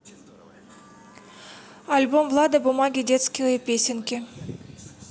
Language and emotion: Russian, neutral